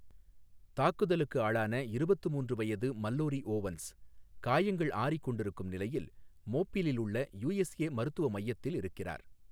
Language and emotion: Tamil, neutral